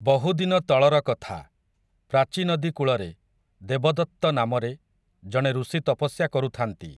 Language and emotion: Odia, neutral